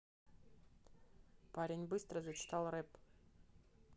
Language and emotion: Russian, neutral